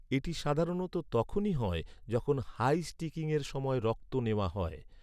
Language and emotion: Bengali, neutral